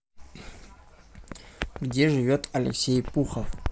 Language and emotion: Russian, neutral